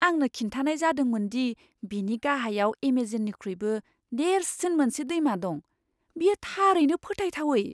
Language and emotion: Bodo, surprised